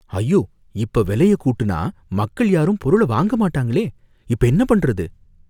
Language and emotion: Tamil, fearful